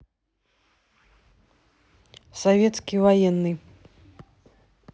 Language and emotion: Russian, neutral